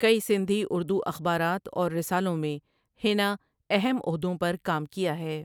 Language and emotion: Urdu, neutral